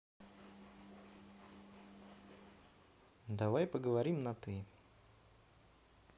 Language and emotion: Russian, neutral